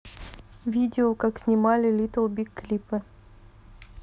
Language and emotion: Russian, neutral